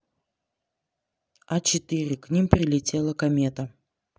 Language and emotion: Russian, neutral